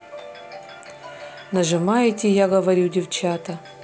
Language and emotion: Russian, neutral